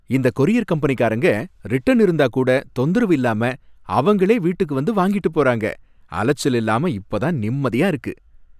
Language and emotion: Tamil, happy